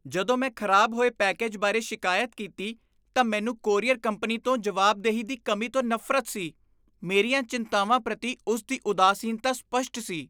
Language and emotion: Punjabi, disgusted